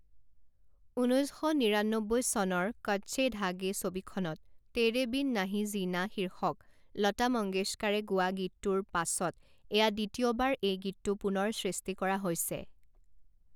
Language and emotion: Assamese, neutral